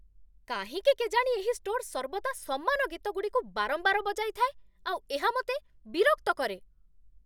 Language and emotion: Odia, angry